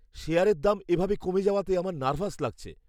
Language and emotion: Bengali, fearful